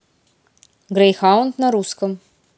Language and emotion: Russian, neutral